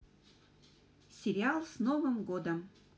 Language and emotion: Russian, positive